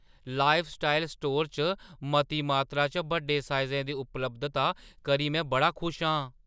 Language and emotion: Dogri, surprised